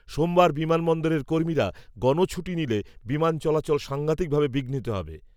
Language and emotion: Bengali, neutral